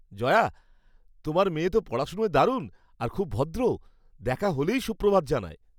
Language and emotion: Bengali, happy